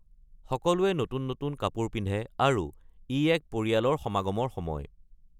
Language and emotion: Assamese, neutral